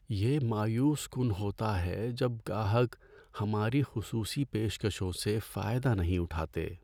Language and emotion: Urdu, sad